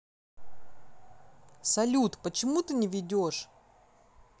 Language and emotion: Russian, angry